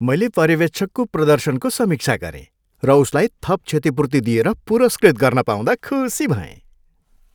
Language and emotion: Nepali, happy